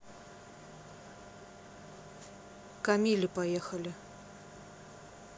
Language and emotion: Russian, neutral